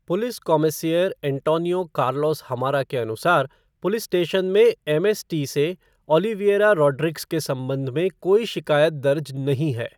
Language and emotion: Hindi, neutral